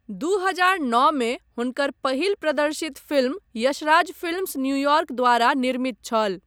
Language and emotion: Maithili, neutral